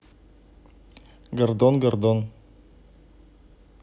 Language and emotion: Russian, neutral